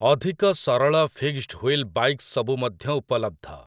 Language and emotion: Odia, neutral